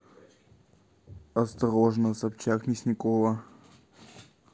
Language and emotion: Russian, neutral